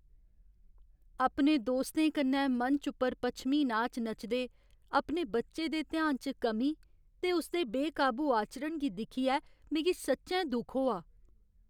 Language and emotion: Dogri, sad